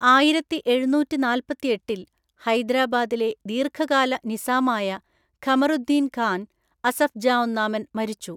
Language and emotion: Malayalam, neutral